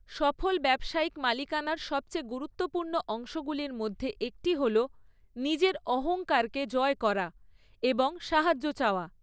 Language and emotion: Bengali, neutral